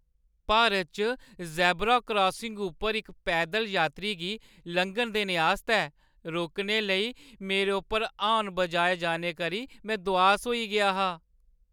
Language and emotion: Dogri, sad